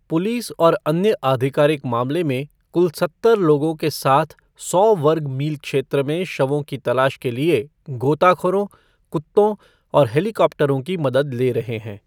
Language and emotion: Hindi, neutral